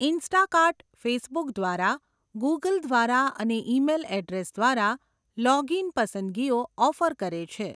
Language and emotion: Gujarati, neutral